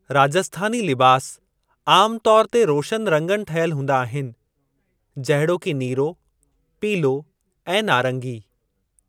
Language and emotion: Sindhi, neutral